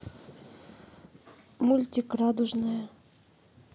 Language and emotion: Russian, neutral